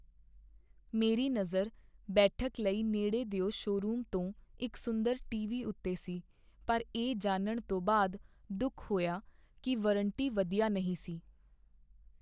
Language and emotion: Punjabi, sad